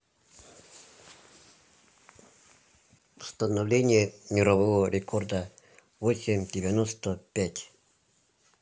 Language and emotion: Russian, neutral